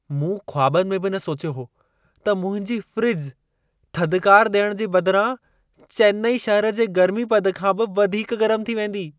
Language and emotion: Sindhi, surprised